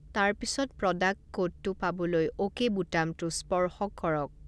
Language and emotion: Assamese, neutral